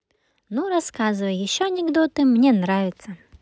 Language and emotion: Russian, positive